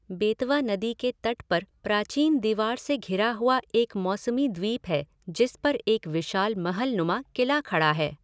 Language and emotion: Hindi, neutral